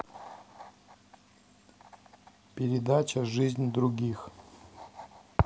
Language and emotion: Russian, neutral